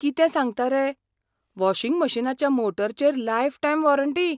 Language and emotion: Goan Konkani, surprised